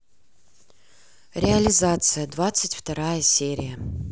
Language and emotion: Russian, neutral